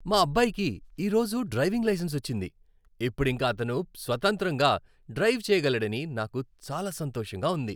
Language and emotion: Telugu, happy